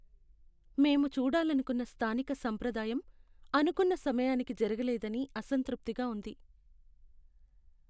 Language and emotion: Telugu, sad